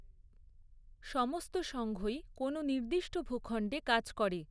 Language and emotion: Bengali, neutral